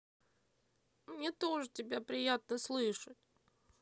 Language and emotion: Russian, sad